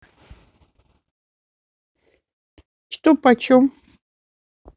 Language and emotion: Russian, neutral